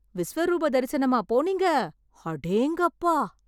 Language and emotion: Tamil, surprised